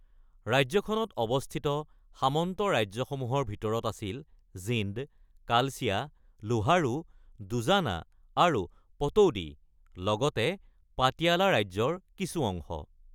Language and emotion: Assamese, neutral